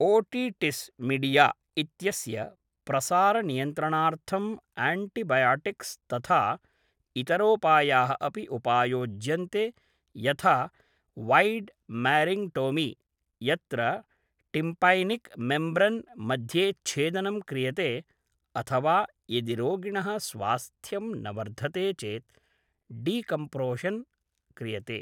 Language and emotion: Sanskrit, neutral